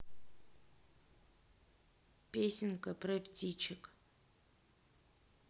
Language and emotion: Russian, neutral